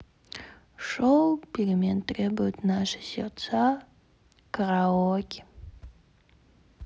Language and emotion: Russian, sad